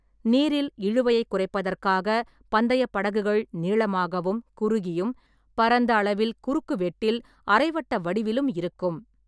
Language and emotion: Tamil, neutral